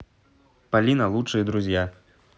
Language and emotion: Russian, positive